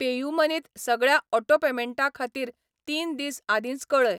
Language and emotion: Goan Konkani, neutral